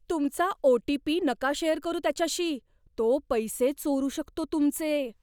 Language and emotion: Marathi, fearful